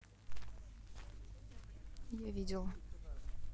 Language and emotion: Russian, neutral